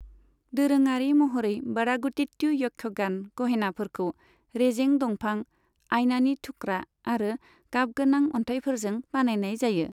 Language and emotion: Bodo, neutral